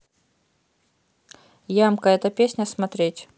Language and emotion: Russian, neutral